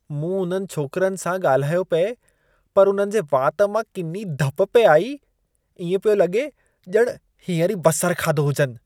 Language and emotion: Sindhi, disgusted